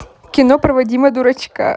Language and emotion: Russian, positive